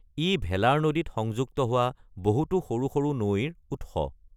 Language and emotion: Assamese, neutral